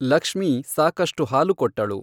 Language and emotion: Kannada, neutral